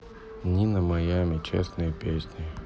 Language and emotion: Russian, neutral